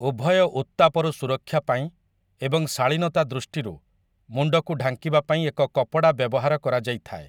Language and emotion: Odia, neutral